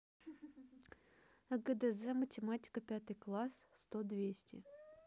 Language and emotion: Russian, neutral